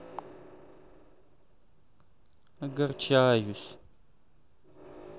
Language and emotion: Russian, sad